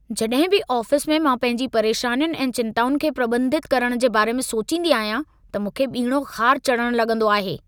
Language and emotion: Sindhi, angry